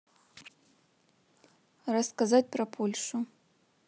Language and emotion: Russian, neutral